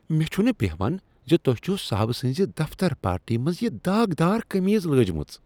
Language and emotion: Kashmiri, disgusted